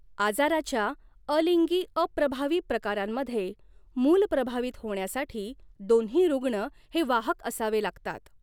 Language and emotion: Marathi, neutral